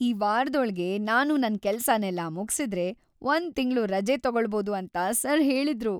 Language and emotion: Kannada, happy